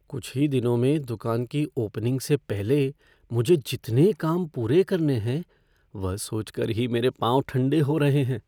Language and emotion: Hindi, fearful